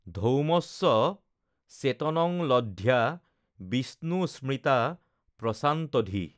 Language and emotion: Assamese, neutral